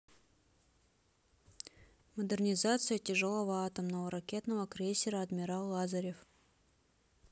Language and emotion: Russian, neutral